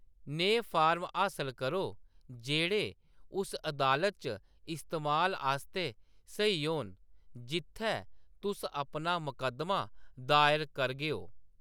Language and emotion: Dogri, neutral